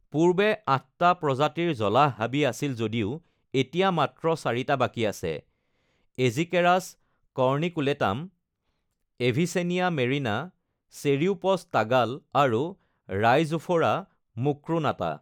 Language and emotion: Assamese, neutral